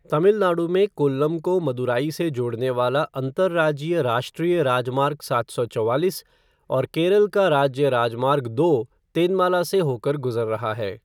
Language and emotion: Hindi, neutral